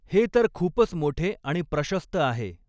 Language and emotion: Marathi, neutral